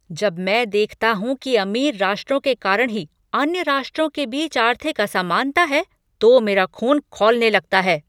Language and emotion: Hindi, angry